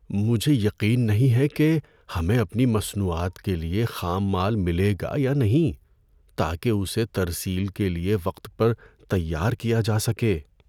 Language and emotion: Urdu, fearful